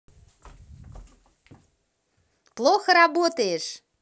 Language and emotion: Russian, positive